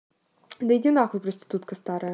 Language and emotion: Russian, neutral